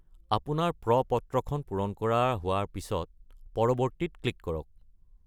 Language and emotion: Assamese, neutral